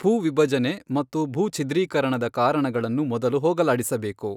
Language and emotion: Kannada, neutral